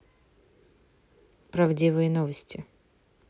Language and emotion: Russian, neutral